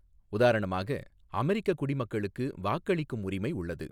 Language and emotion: Tamil, neutral